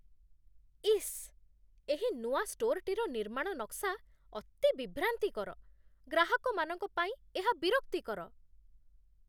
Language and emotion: Odia, disgusted